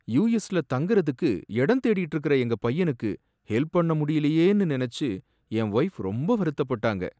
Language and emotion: Tamil, sad